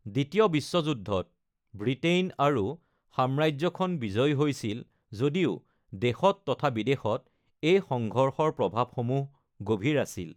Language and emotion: Assamese, neutral